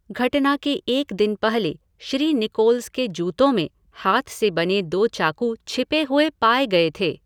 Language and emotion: Hindi, neutral